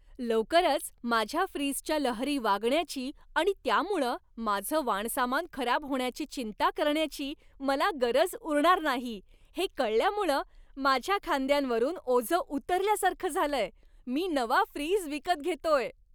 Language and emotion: Marathi, happy